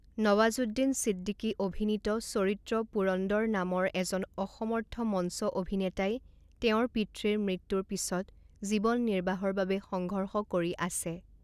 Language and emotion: Assamese, neutral